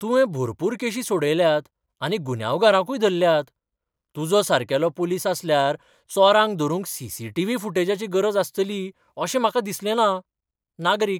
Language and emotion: Goan Konkani, surprised